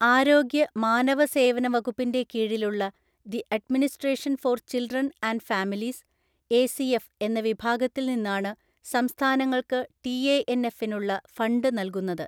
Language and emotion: Malayalam, neutral